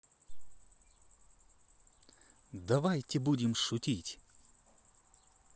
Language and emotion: Russian, positive